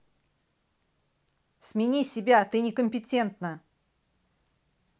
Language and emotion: Russian, angry